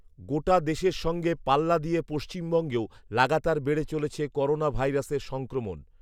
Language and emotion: Bengali, neutral